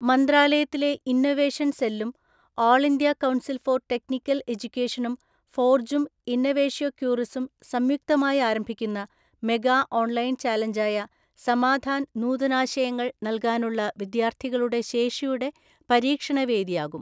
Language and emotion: Malayalam, neutral